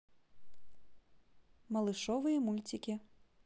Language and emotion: Russian, positive